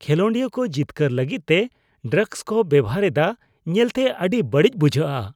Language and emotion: Santali, disgusted